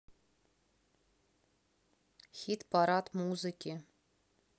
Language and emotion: Russian, neutral